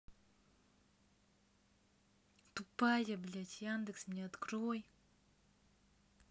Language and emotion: Russian, angry